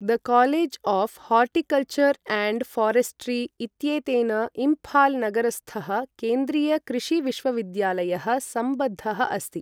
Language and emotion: Sanskrit, neutral